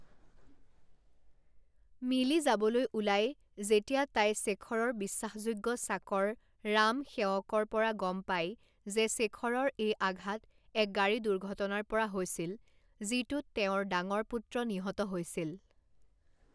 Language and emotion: Assamese, neutral